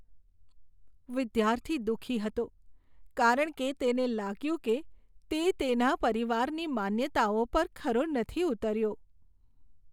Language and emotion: Gujarati, sad